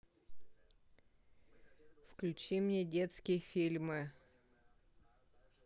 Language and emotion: Russian, neutral